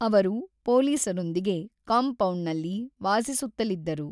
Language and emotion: Kannada, neutral